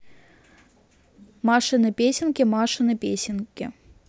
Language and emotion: Russian, neutral